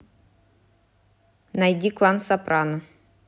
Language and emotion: Russian, neutral